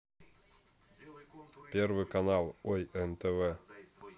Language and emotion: Russian, neutral